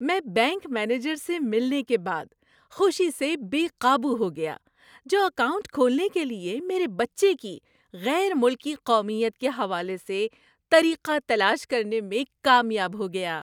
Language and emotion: Urdu, happy